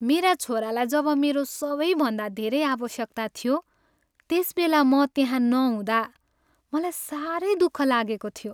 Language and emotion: Nepali, sad